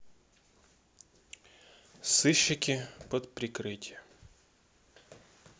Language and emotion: Russian, sad